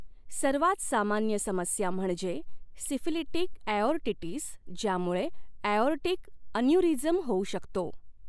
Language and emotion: Marathi, neutral